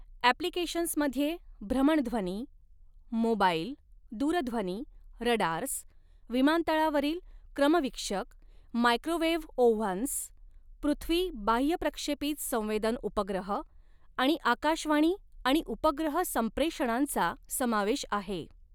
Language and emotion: Marathi, neutral